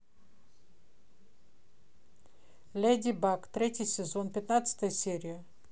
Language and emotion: Russian, neutral